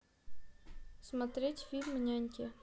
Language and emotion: Russian, neutral